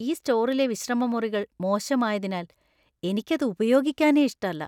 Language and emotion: Malayalam, disgusted